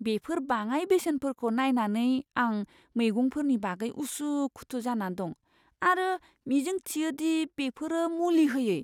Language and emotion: Bodo, fearful